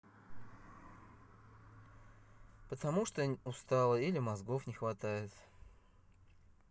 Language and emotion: Russian, neutral